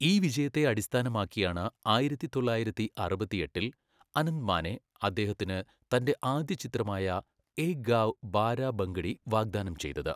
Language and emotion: Malayalam, neutral